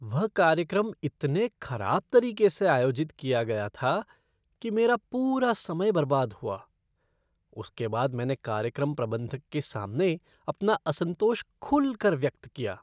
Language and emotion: Hindi, disgusted